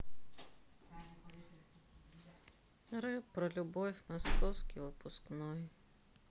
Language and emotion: Russian, sad